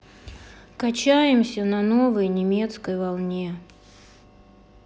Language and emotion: Russian, sad